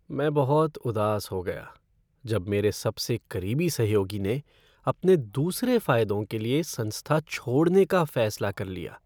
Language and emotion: Hindi, sad